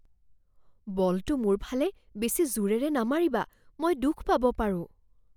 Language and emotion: Assamese, fearful